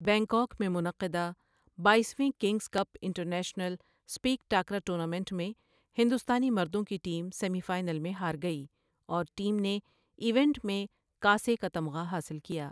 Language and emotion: Urdu, neutral